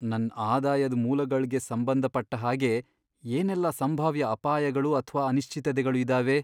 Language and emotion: Kannada, fearful